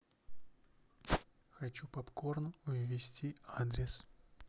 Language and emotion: Russian, neutral